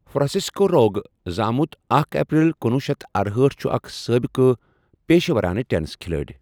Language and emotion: Kashmiri, neutral